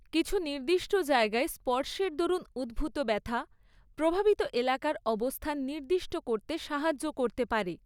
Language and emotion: Bengali, neutral